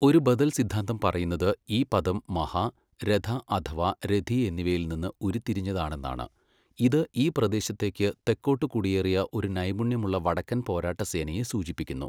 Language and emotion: Malayalam, neutral